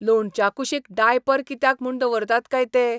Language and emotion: Goan Konkani, disgusted